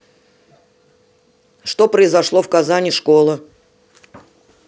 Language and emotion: Russian, neutral